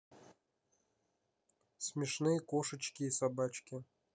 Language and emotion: Russian, neutral